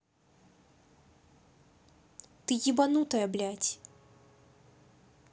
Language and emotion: Russian, angry